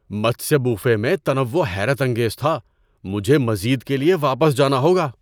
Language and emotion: Urdu, surprised